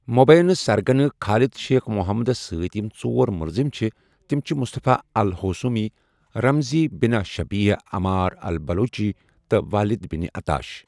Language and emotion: Kashmiri, neutral